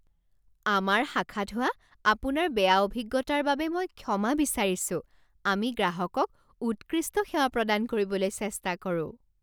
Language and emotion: Assamese, surprised